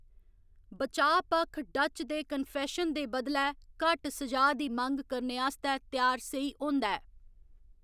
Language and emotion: Dogri, neutral